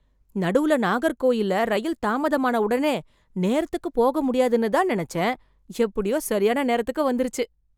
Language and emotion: Tamil, surprised